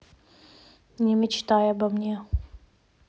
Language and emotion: Russian, neutral